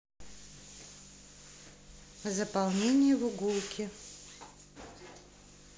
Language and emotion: Russian, neutral